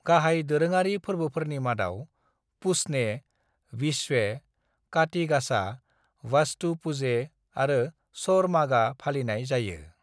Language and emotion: Bodo, neutral